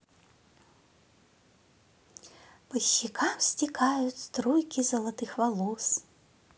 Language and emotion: Russian, positive